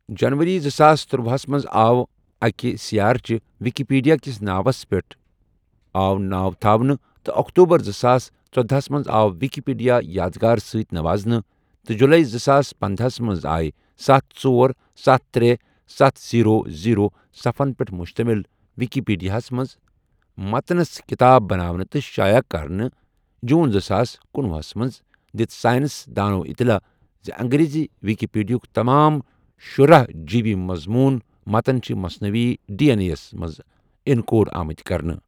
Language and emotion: Kashmiri, neutral